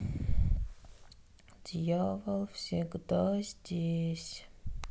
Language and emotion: Russian, sad